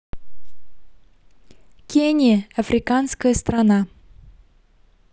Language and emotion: Russian, neutral